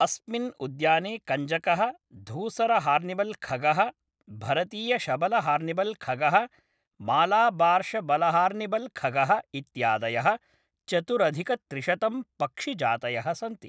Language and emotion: Sanskrit, neutral